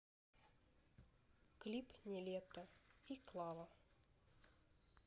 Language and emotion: Russian, neutral